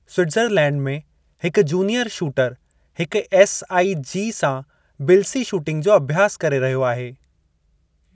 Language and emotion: Sindhi, neutral